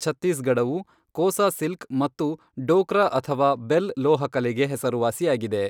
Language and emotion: Kannada, neutral